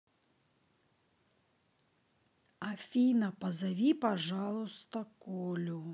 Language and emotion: Russian, neutral